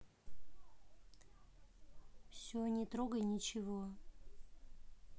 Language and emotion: Russian, neutral